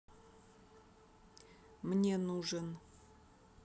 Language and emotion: Russian, neutral